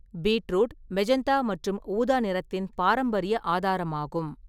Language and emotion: Tamil, neutral